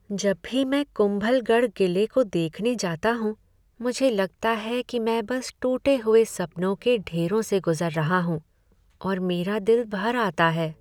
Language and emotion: Hindi, sad